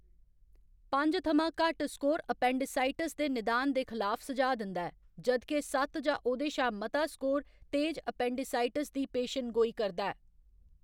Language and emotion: Dogri, neutral